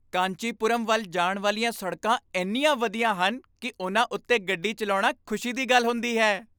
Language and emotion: Punjabi, happy